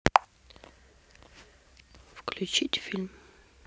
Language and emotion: Russian, neutral